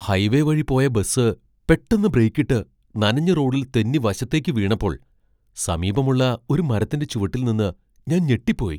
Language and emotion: Malayalam, surprised